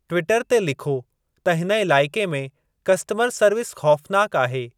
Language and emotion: Sindhi, neutral